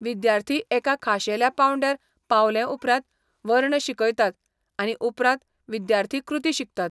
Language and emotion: Goan Konkani, neutral